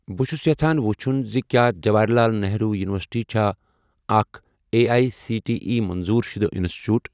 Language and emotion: Kashmiri, neutral